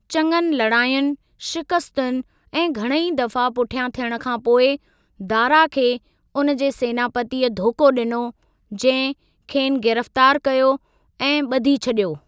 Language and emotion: Sindhi, neutral